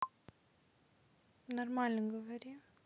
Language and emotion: Russian, neutral